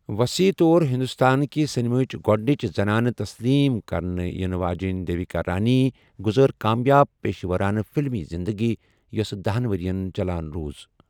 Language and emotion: Kashmiri, neutral